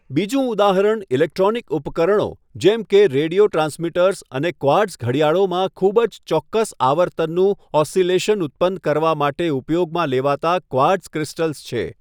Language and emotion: Gujarati, neutral